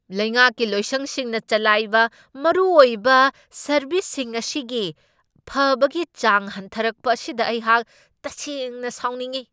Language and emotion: Manipuri, angry